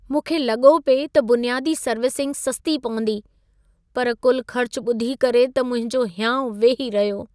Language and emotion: Sindhi, sad